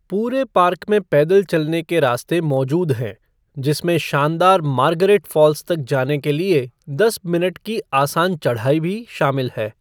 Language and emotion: Hindi, neutral